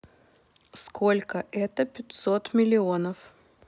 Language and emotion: Russian, neutral